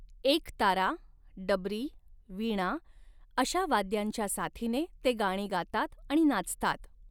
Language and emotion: Marathi, neutral